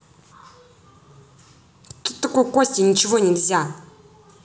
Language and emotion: Russian, angry